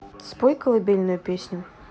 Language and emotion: Russian, neutral